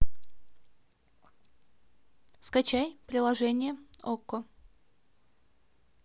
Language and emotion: Russian, neutral